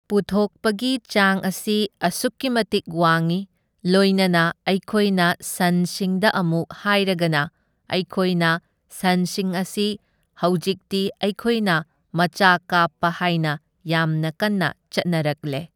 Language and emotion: Manipuri, neutral